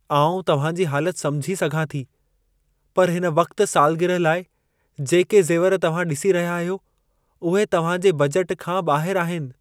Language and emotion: Sindhi, sad